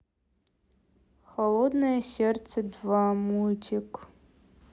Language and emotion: Russian, neutral